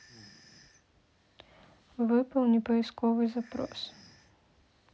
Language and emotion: Russian, neutral